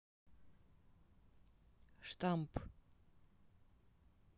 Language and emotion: Russian, neutral